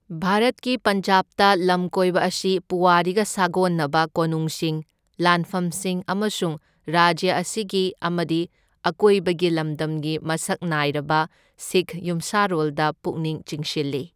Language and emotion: Manipuri, neutral